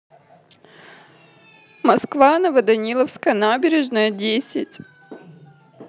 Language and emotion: Russian, sad